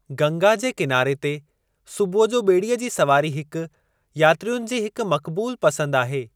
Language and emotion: Sindhi, neutral